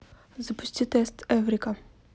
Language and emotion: Russian, neutral